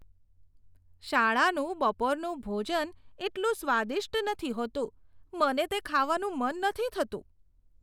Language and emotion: Gujarati, disgusted